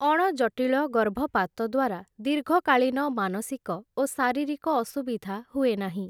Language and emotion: Odia, neutral